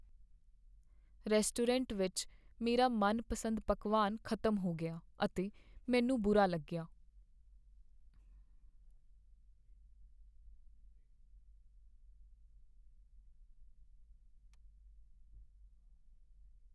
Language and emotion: Punjabi, sad